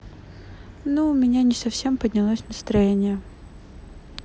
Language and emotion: Russian, sad